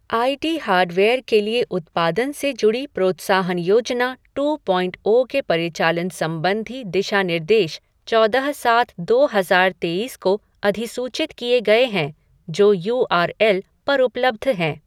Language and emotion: Hindi, neutral